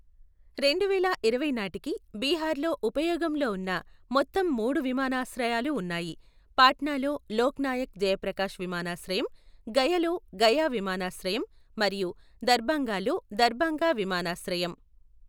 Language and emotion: Telugu, neutral